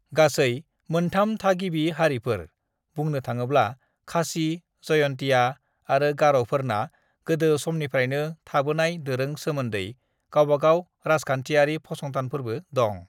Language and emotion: Bodo, neutral